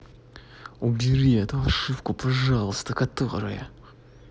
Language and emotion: Russian, angry